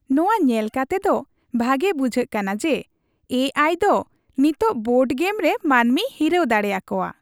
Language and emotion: Santali, happy